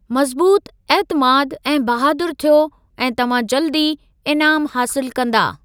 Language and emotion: Sindhi, neutral